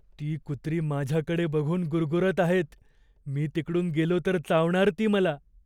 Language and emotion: Marathi, fearful